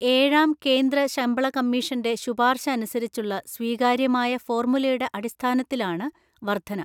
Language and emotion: Malayalam, neutral